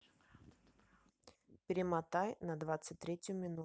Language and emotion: Russian, neutral